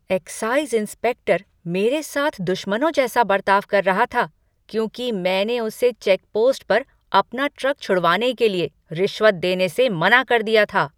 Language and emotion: Hindi, angry